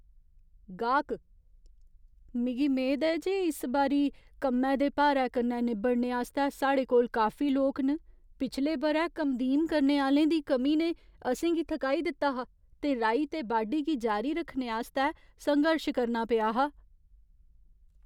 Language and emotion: Dogri, fearful